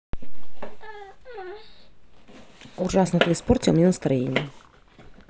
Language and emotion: Russian, neutral